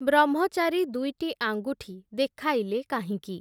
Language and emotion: Odia, neutral